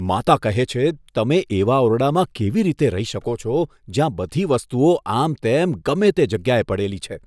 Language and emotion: Gujarati, disgusted